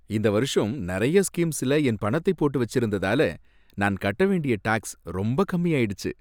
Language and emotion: Tamil, happy